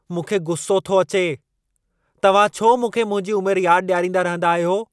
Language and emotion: Sindhi, angry